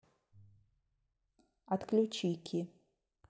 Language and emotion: Russian, neutral